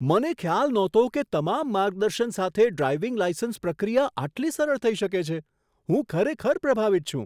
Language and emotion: Gujarati, surprised